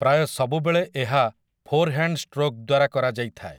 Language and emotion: Odia, neutral